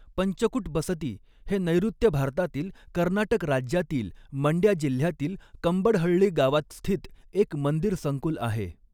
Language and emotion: Marathi, neutral